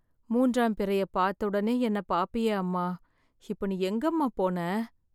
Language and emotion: Tamil, sad